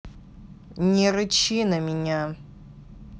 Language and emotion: Russian, angry